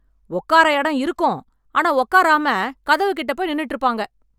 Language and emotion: Tamil, angry